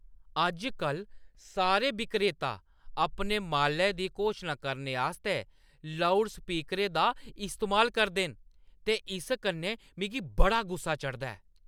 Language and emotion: Dogri, angry